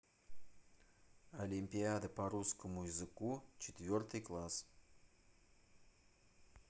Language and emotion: Russian, neutral